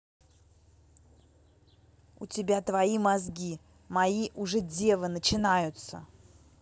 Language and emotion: Russian, angry